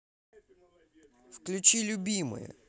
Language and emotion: Russian, neutral